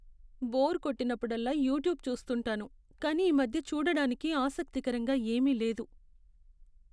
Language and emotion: Telugu, sad